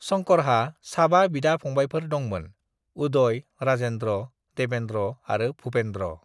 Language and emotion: Bodo, neutral